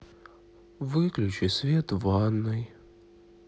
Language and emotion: Russian, sad